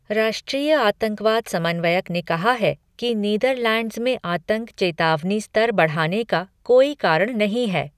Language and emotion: Hindi, neutral